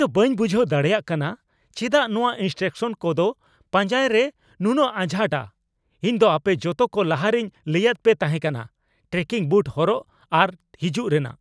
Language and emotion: Santali, angry